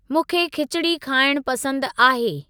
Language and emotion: Sindhi, neutral